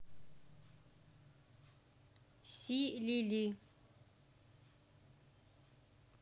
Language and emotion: Russian, neutral